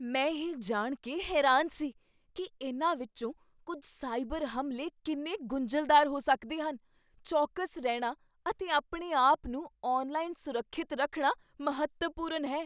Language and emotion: Punjabi, surprised